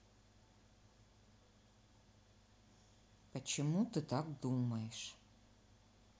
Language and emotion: Russian, neutral